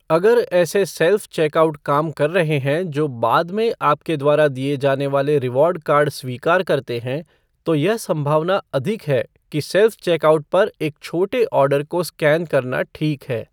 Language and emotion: Hindi, neutral